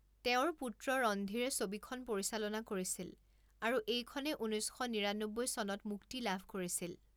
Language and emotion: Assamese, neutral